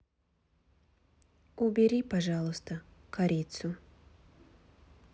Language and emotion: Russian, neutral